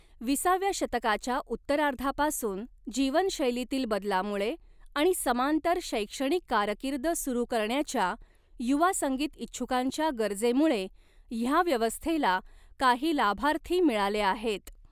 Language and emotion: Marathi, neutral